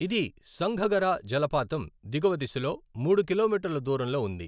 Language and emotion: Telugu, neutral